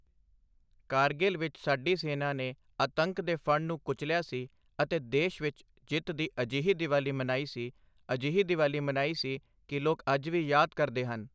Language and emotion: Punjabi, neutral